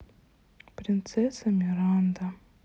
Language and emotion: Russian, sad